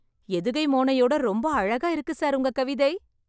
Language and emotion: Tamil, happy